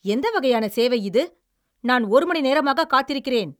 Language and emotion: Tamil, angry